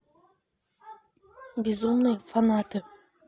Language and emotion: Russian, neutral